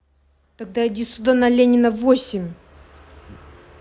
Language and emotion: Russian, angry